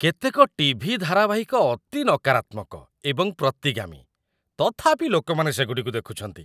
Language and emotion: Odia, disgusted